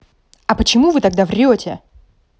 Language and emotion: Russian, angry